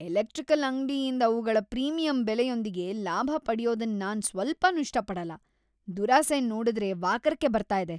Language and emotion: Kannada, disgusted